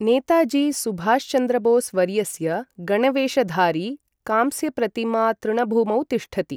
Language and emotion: Sanskrit, neutral